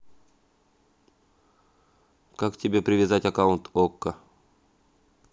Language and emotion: Russian, neutral